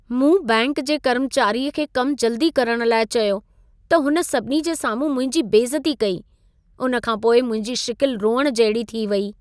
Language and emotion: Sindhi, sad